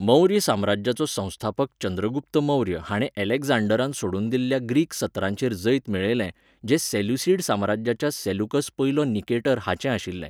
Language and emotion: Goan Konkani, neutral